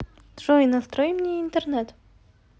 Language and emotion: Russian, neutral